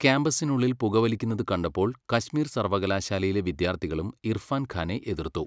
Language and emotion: Malayalam, neutral